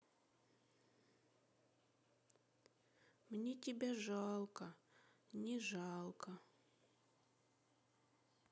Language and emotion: Russian, sad